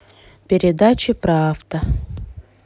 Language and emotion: Russian, neutral